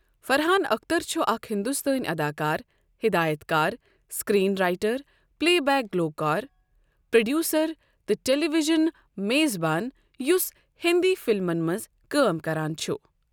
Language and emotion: Kashmiri, neutral